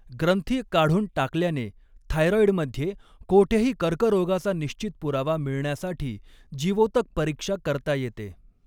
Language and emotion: Marathi, neutral